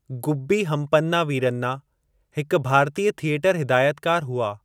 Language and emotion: Sindhi, neutral